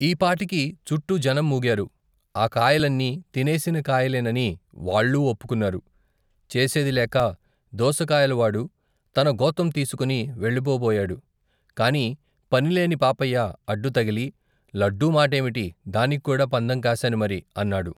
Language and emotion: Telugu, neutral